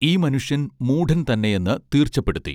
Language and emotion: Malayalam, neutral